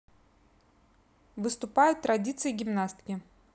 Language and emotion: Russian, neutral